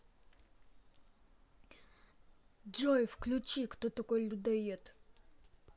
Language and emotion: Russian, neutral